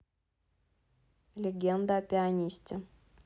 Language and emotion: Russian, neutral